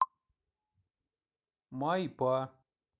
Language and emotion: Russian, neutral